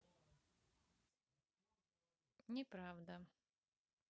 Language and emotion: Russian, neutral